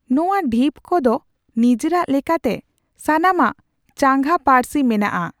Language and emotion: Santali, neutral